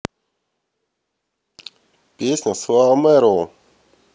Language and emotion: Russian, neutral